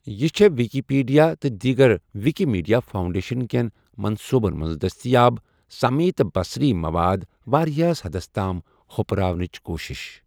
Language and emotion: Kashmiri, neutral